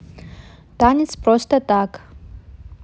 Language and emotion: Russian, neutral